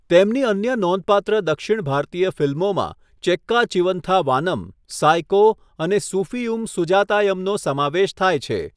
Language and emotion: Gujarati, neutral